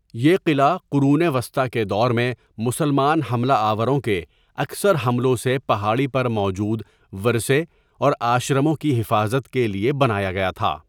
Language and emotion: Urdu, neutral